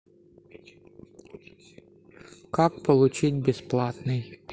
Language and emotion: Russian, neutral